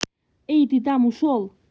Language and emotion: Russian, angry